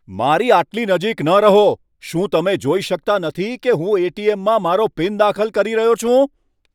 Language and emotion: Gujarati, angry